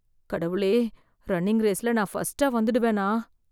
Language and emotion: Tamil, fearful